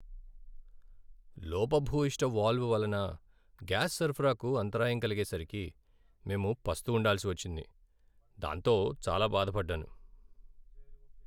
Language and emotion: Telugu, sad